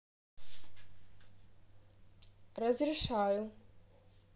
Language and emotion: Russian, neutral